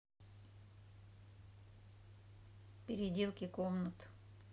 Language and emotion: Russian, neutral